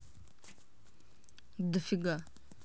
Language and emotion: Russian, neutral